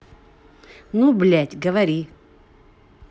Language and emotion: Russian, angry